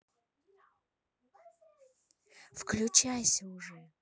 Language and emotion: Russian, neutral